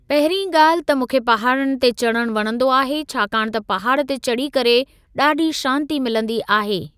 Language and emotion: Sindhi, neutral